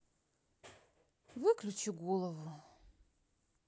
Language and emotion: Russian, neutral